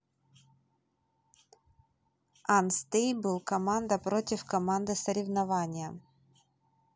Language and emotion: Russian, neutral